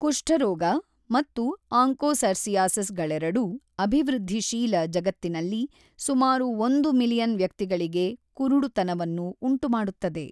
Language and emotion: Kannada, neutral